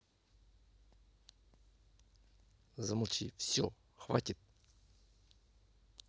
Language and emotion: Russian, angry